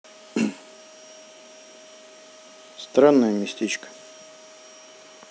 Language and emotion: Russian, neutral